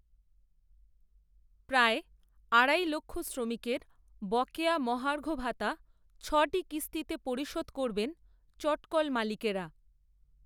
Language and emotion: Bengali, neutral